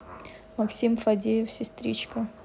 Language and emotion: Russian, neutral